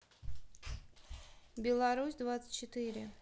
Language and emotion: Russian, neutral